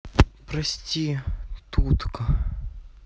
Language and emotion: Russian, sad